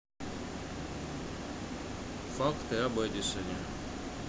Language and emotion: Russian, neutral